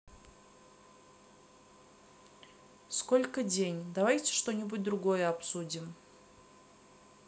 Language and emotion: Russian, neutral